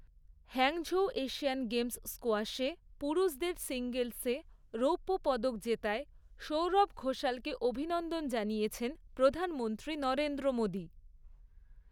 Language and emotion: Bengali, neutral